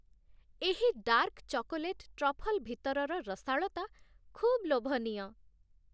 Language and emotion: Odia, happy